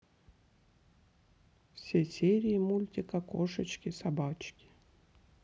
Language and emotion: Russian, neutral